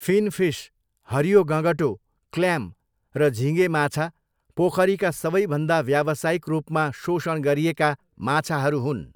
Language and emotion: Nepali, neutral